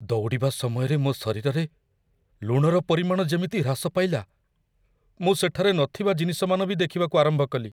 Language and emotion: Odia, fearful